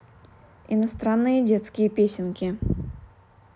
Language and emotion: Russian, neutral